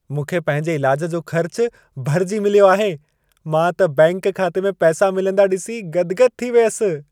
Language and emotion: Sindhi, happy